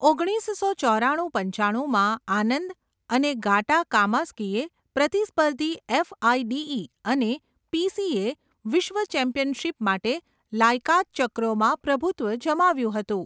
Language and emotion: Gujarati, neutral